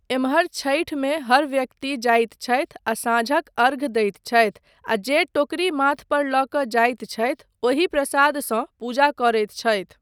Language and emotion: Maithili, neutral